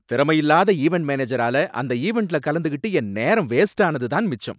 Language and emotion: Tamil, angry